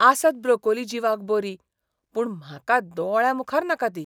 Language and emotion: Goan Konkani, disgusted